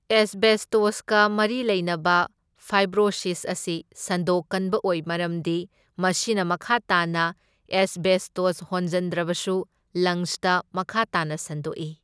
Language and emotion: Manipuri, neutral